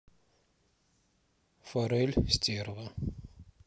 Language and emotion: Russian, neutral